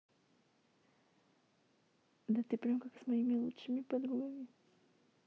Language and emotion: Russian, sad